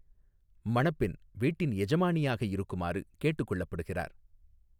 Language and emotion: Tamil, neutral